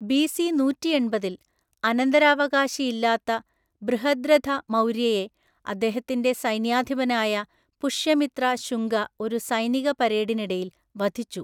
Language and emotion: Malayalam, neutral